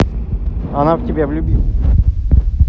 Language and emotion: Russian, neutral